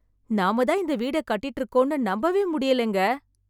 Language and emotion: Tamil, surprised